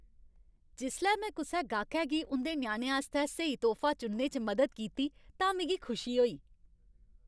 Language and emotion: Dogri, happy